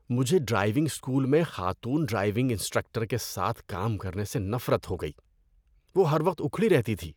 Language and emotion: Urdu, disgusted